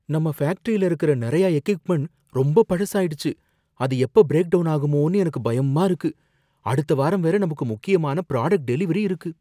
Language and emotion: Tamil, fearful